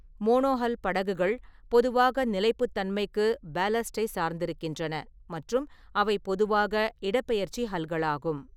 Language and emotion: Tamil, neutral